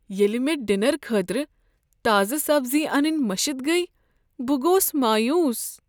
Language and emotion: Kashmiri, sad